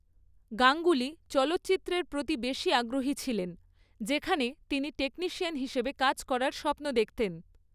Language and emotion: Bengali, neutral